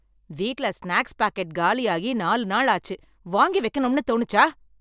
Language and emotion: Tamil, angry